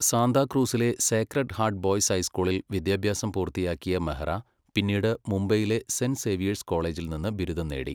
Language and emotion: Malayalam, neutral